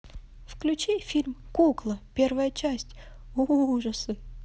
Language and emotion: Russian, positive